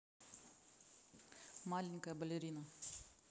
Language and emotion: Russian, neutral